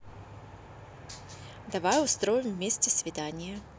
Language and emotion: Russian, positive